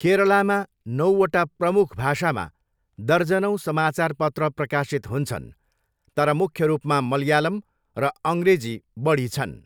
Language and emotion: Nepali, neutral